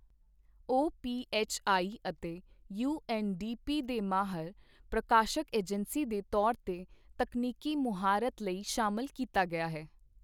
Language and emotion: Punjabi, neutral